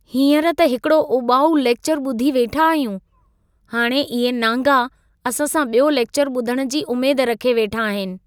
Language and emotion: Sindhi, disgusted